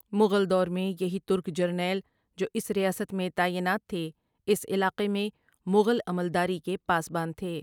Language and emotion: Urdu, neutral